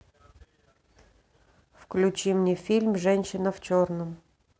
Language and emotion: Russian, neutral